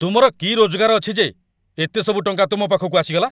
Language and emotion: Odia, angry